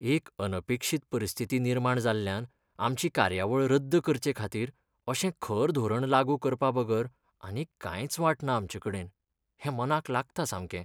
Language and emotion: Goan Konkani, sad